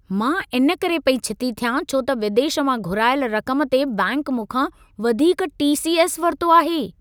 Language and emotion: Sindhi, angry